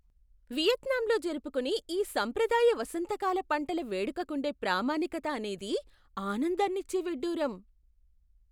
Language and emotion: Telugu, surprised